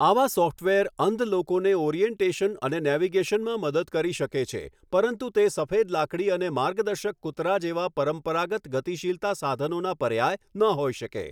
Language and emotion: Gujarati, neutral